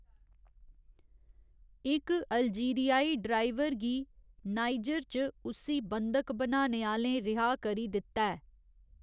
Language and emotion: Dogri, neutral